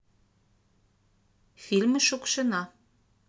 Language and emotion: Russian, neutral